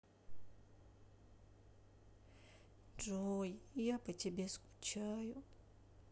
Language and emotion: Russian, sad